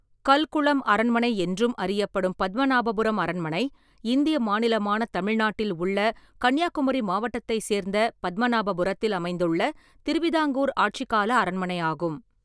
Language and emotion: Tamil, neutral